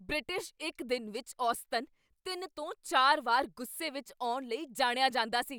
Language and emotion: Punjabi, angry